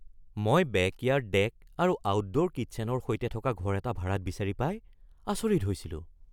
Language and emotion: Assamese, surprised